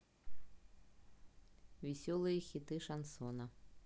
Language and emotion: Russian, neutral